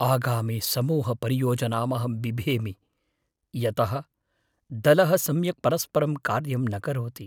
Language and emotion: Sanskrit, fearful